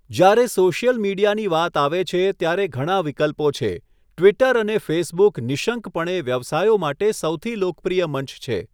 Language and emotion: Gujarati, neutral